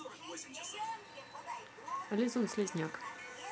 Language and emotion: Russian, neutral